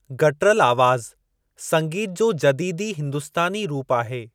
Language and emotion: Sindhi, neutral